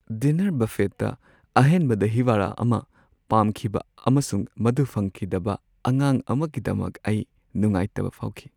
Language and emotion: Manipuri, sad